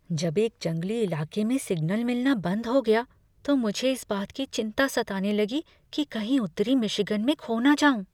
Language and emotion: Hindi, fearful